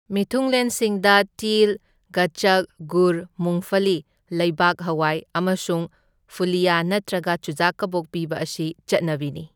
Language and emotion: Manipuri, neutral